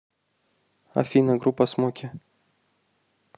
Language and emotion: Russian, neutral